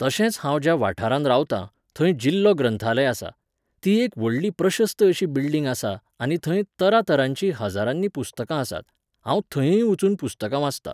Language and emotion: Goan Konkani, neutral